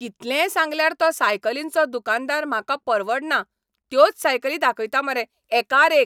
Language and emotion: Goan Konkani, angry